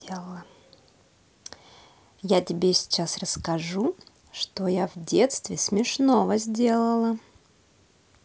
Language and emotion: Russian, positive